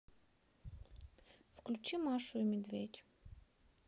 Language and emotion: Russian, sad